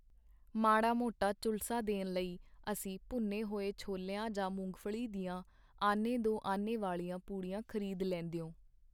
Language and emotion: Punjabi, neutral